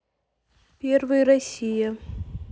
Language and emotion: Russian, neutral